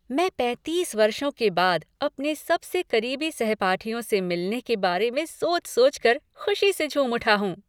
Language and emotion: Hindi, happy